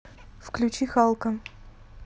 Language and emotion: Russian, neutral